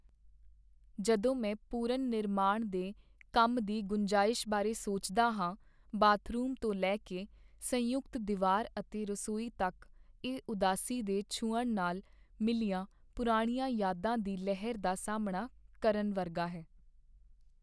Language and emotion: Punjabi, sad